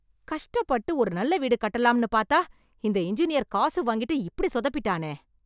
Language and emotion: Tamil, angry